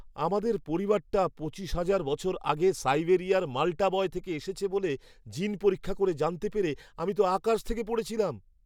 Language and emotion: Bengali, surprised